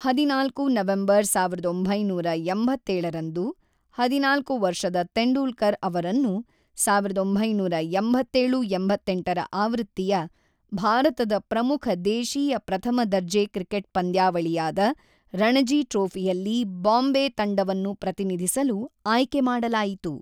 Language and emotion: Kannada, neutral